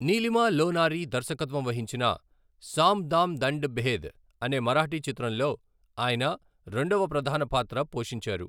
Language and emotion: Telugu, neutral